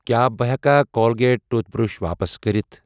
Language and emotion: Kashmiri, neutral